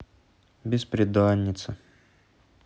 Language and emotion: Russian, sad